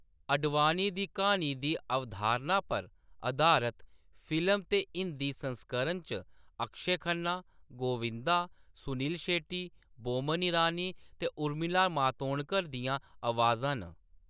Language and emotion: Dogri, neutral